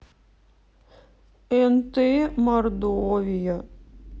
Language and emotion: Russian, sad